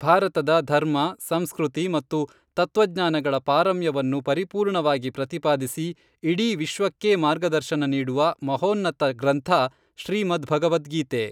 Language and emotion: Kannada, neutral